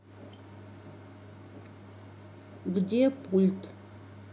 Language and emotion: Russian, neutral